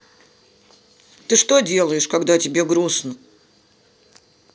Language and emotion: Russian, sad